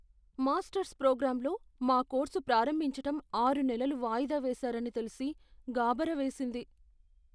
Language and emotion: Telugu, fearful